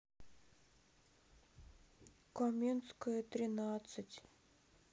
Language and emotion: Russian, sad